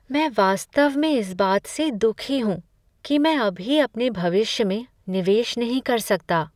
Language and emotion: Hindi, sad